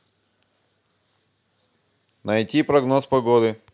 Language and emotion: Russian, neutral